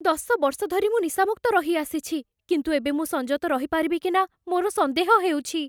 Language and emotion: Odia, fearful